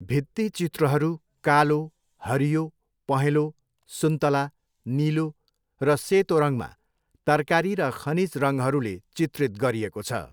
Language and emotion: Nepali, neutral